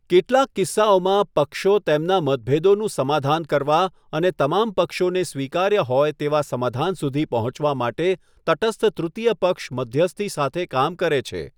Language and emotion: Gujarati, neutral